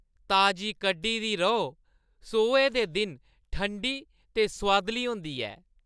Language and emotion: Dogri, happy